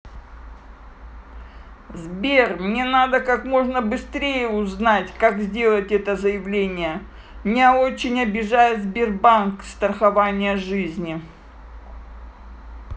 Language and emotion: Russian, neutral